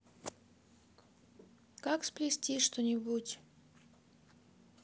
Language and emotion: Russian, neutral